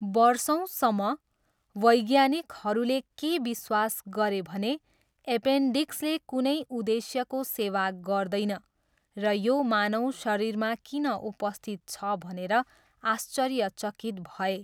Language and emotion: Nepali, neutral